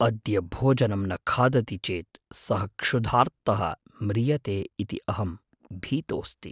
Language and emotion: Sanskrit, fearful